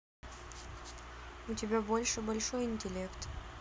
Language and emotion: Russian, neutral